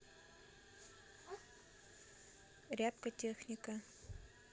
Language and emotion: Russian, neutral